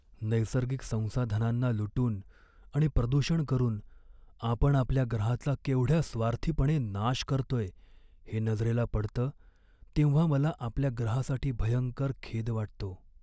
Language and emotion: Marathi, sad